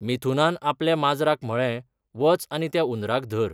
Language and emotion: Goan Konkani, neutral